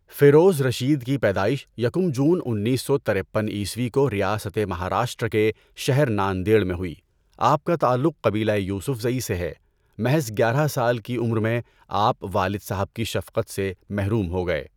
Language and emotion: Urdu, neutral